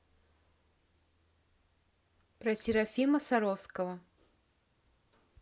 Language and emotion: Russian, neutral